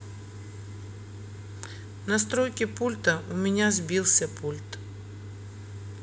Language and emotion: Russian, neutral